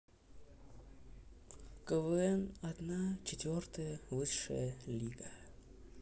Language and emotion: Russian, neutral